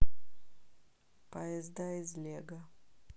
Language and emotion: Russian, neutral